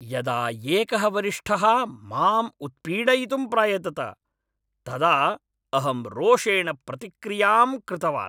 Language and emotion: Sanskrit, angry